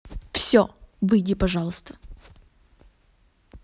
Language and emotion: Russian, angry